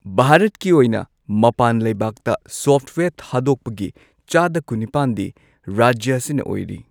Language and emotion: Manipuri, neutral